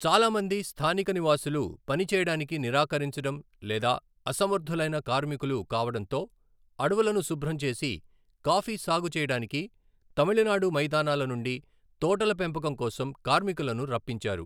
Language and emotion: Telugu, neutral